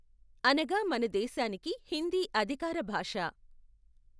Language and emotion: Telugu, neutral